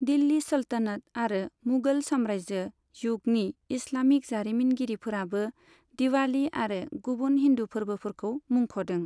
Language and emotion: Bodo, neutral